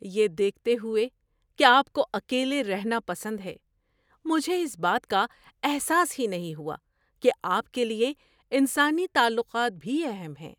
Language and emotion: Urdu, surprised